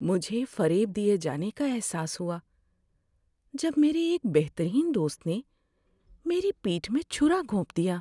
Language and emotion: Urdu, sad